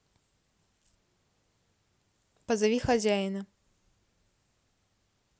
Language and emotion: Russian, neutral